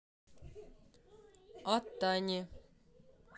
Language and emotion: Russian, neutral